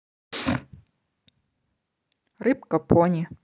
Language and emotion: Russian, neutral